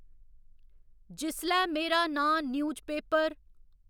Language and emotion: Dogri, neutral